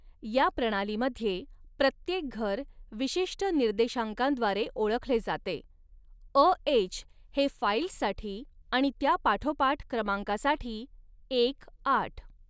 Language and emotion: Marathi, neutral